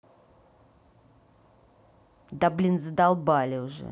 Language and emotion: Russian, angry